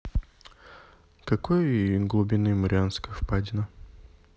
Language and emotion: Russian, neutral